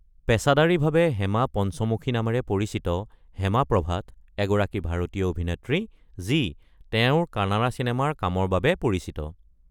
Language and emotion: Assamese, neutral